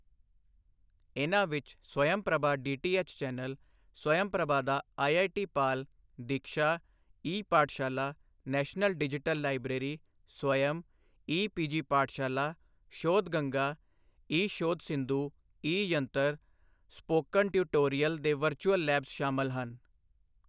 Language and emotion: Punjabi, neutral